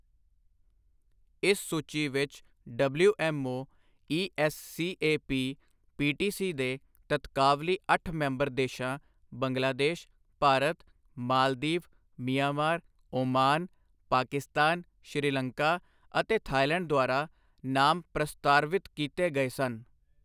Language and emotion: Punjabi, neutral